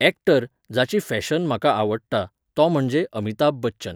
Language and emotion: Goan Konkani, neutral